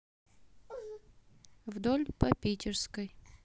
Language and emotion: Russian, neutral